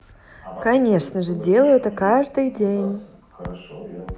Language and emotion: Russian, positive